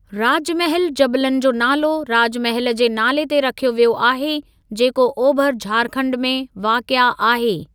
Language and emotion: Sindhi, neutral